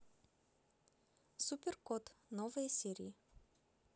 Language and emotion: Russian, neutral